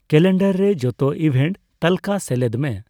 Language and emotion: Santali, neutral